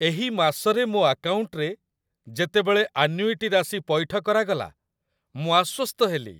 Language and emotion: Odia, happy